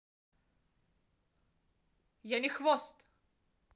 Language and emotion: Russian, angry